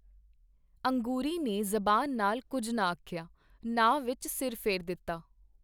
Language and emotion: Punjabi, neutral